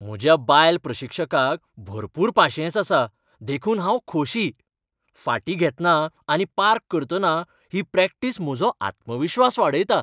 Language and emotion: Goan Konkani, happy